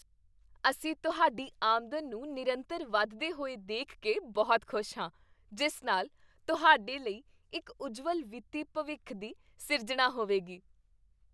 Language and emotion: Punjabi, happy